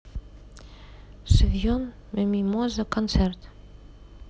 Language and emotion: Russian, neutral